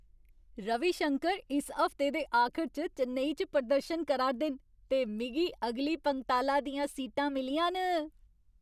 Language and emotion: Dogri, happy